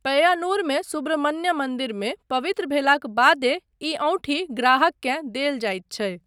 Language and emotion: Maithili, neutral